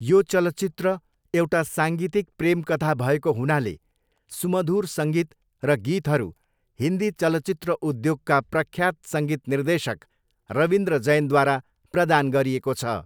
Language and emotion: Nepali, neutral